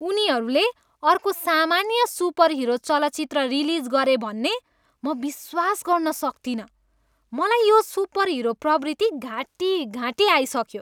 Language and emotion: Nepali, disgusted